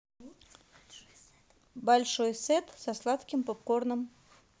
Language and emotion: Russian, neutral